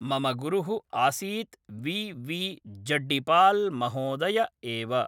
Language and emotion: Sanskrit, neutral